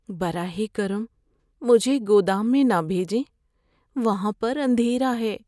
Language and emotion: Urdu, fearful